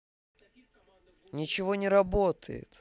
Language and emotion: Russian, angry